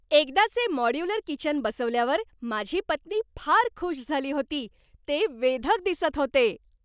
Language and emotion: Marathi, happy